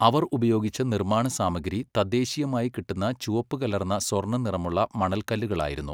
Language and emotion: Malayalam, neutral